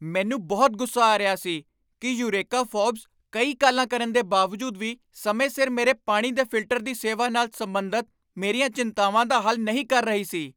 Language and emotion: Punjabi, angry